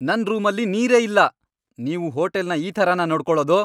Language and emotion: Kannada, angry